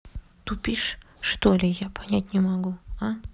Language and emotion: Russian, neutral